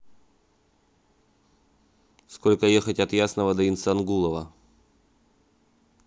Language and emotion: Russian, neutral